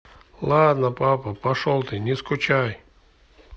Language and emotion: Russian, neutral